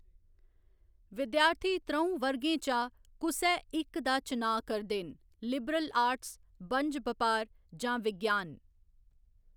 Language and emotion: Dogri, neutral